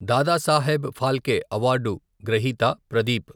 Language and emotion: Telugu, neutral